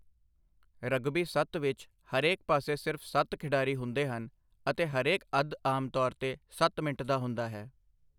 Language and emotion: Punjabi, neutral